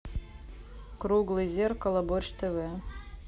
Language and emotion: Russian, neutral